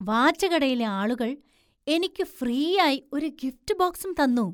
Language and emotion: Malayalam, surprised